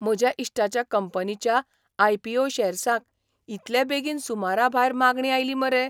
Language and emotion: Goan Konkani, surprised